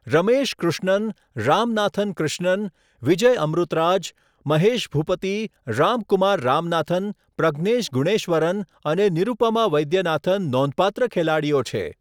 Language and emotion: Gujarati, neutral